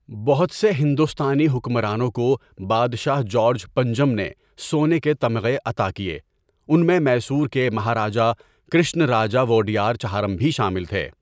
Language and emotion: Urdu, neutral